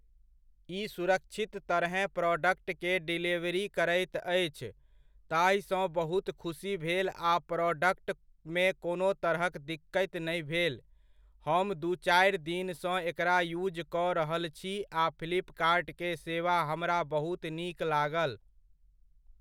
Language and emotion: Maithili, neutral